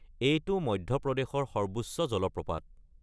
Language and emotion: Assamese, neutral